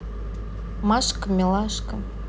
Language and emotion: Russian, neutral